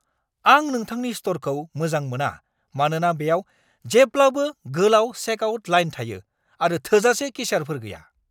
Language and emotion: Bodo, angry